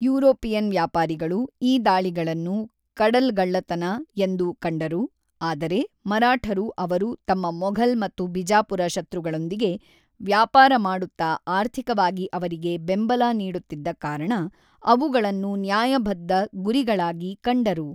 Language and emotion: Kannada, neutral